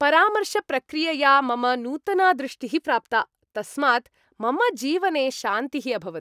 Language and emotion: Sanskrit, happy